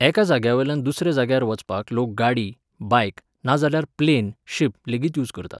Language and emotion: Goan Konkani, neutral